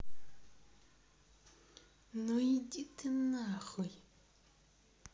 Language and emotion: Russian, angry